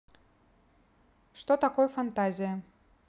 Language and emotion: Russian, neutral